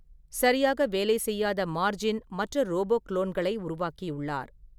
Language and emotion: Tamil, neutral